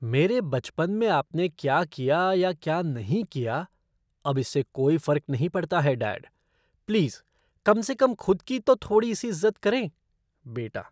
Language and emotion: Hindi, disgusted